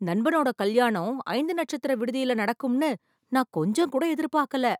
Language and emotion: Tamil, surprised